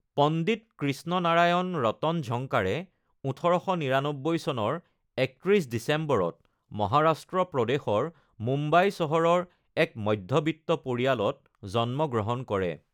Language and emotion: Assamese, neutral